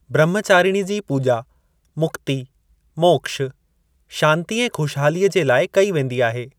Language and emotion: Sindhi, neutral